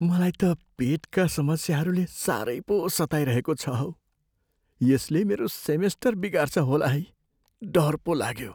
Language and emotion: Nepali, fearful